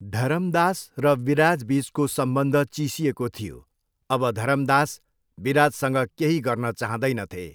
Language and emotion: Nepali, neutral